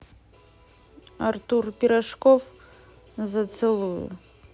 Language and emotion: Russian, neutral